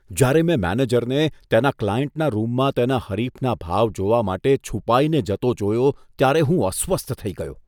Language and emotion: Gujarati, disgusted